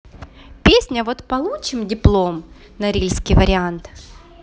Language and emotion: Russian, neutral